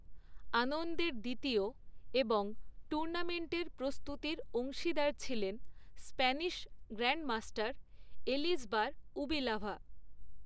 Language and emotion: Bengali, neutral